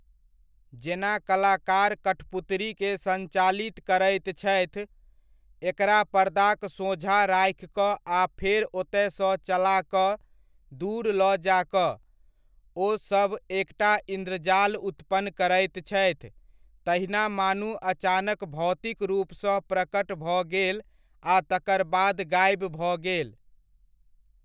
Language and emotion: Maithili, neutral